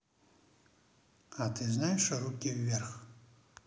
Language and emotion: Russian, neutral